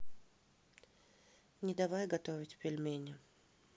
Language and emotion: Russian, neutral